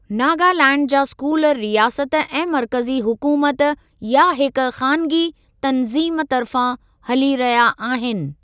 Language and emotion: Sindhi, neutral